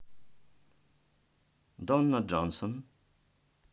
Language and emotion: Russian, neutral